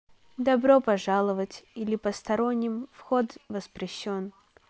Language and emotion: Russian, neutral